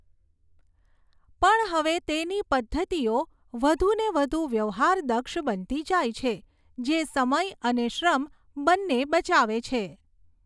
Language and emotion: Gujarati, neutral